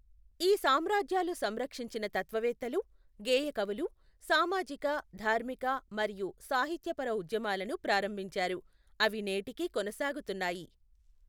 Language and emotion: Telugu, neutral